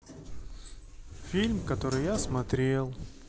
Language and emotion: Russian, sad